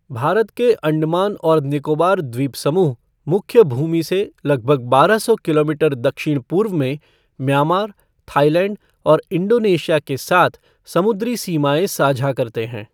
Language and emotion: Hindi, neutral